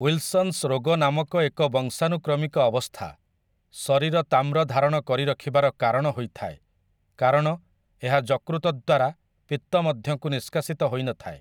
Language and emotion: Odia, neutral